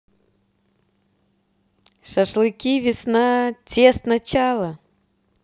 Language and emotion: Russian, positive